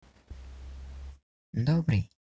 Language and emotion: Russian, neutral